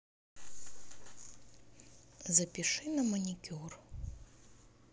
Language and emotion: Russian, neutral